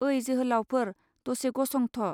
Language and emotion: Bodo, neutral